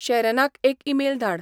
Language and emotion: Goan Konkani, neutral